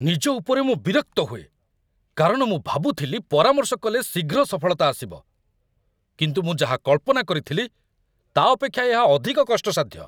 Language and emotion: Odia, angry